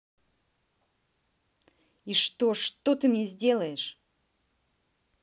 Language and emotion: Russian, angry